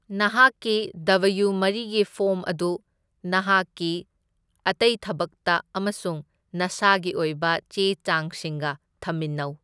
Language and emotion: Manipuri, neutral